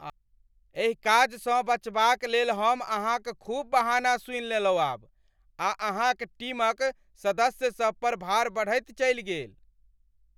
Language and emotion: Maithili, angry